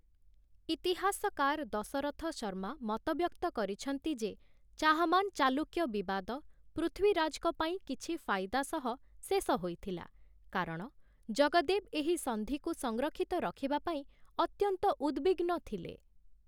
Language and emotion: Odia, neutral